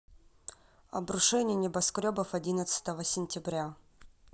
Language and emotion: Russian, neutral